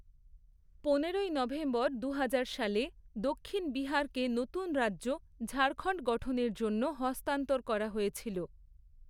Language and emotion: Bengali, neutral